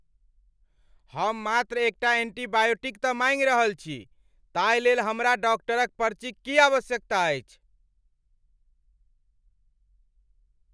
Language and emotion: Maithili, angry